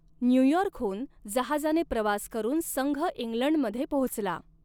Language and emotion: Marathi, neutral